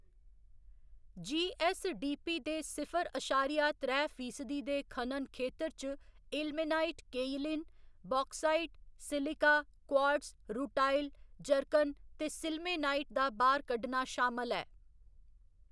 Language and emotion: Dogri, neutral